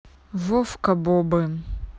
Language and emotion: Russian, neutral